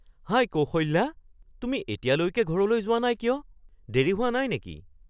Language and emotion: Assamese, surprised